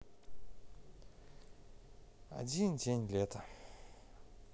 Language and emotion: Russian, sad